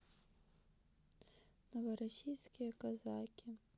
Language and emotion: Russian, sad